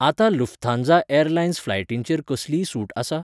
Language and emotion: Goan Konkani, neutral